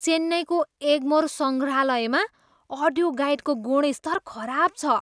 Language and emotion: Nepali, disgusted